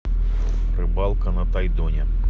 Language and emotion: Russian, neutral